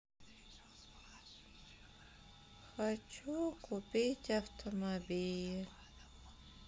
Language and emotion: Russian, sad